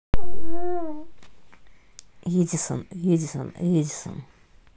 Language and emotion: Russian, neutral